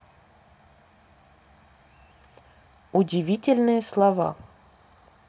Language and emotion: Russian, neutral